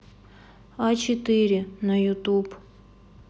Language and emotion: Russian, neutral